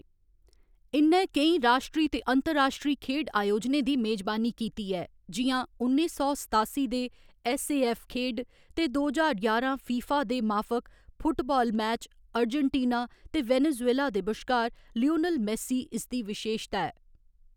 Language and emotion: Dogri, neutral